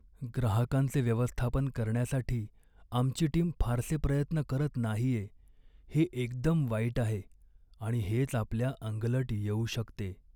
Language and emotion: Marathi, sad